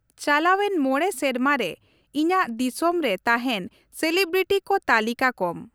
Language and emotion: Santali, neutral